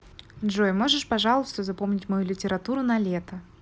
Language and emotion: Russian, neutral